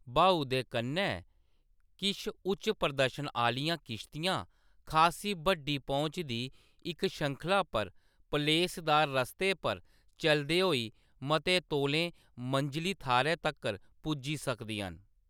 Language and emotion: Dogri, neutral